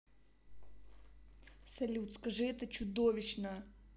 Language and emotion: Russian, angry